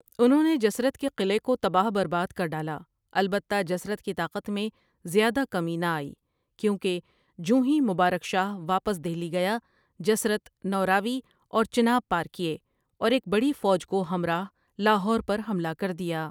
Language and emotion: Urdu, neutral